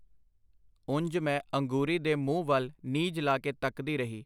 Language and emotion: Punjabi, neutral